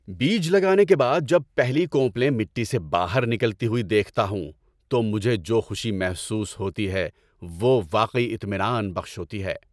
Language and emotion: Urdu, happy